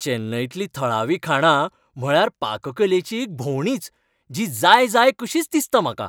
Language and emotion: Goan Konkani, happy